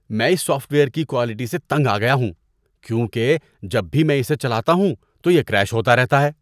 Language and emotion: Urdu, disgusted